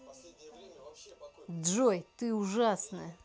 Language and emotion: Russian, angry